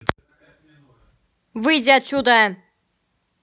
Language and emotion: Russian, angry